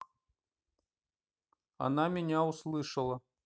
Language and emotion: Russian, neutral